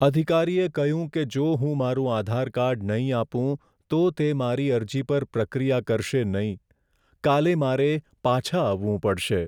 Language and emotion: Gujarati, sad